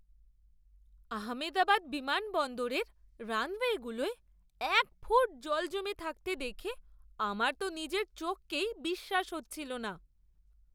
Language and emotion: Bengali, surprised